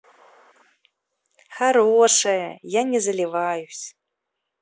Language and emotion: Russian, positive